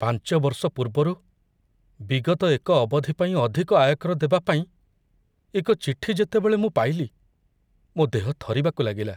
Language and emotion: Odia, fearful